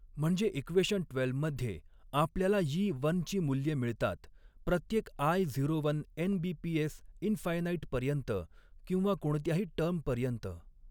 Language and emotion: Marathi, neutral